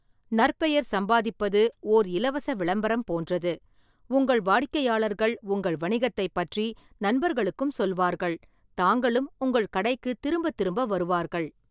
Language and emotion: Tamil, neutral